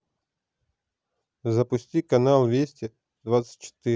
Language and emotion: Russian, neutral